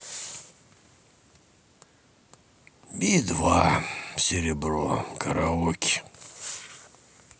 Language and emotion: Russian, sad